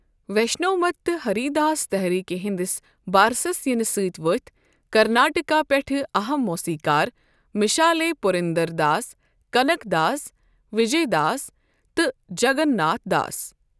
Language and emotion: Kashmiri, neutral